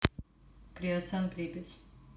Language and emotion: Russian, neutral